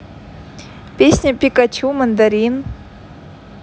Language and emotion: Russian, positive